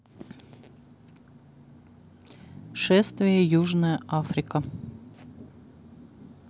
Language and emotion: Russian, neutral